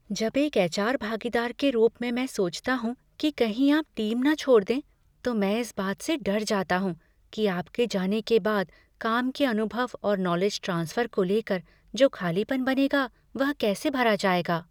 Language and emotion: Hindi, fearful